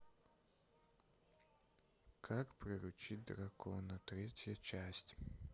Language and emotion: Russian, neutral